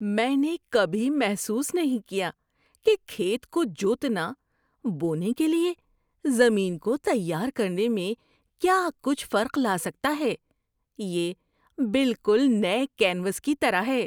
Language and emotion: Urdu, surprised